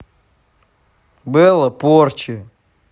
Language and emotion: Russian, neutral